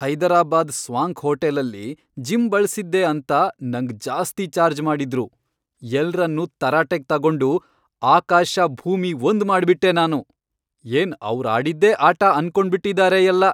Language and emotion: Kannada, angry